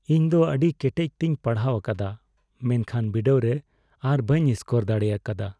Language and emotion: Santali, sad